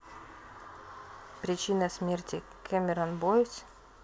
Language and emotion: Russian, neutral